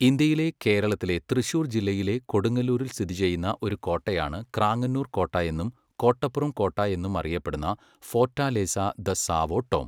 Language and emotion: Malayalam, neutral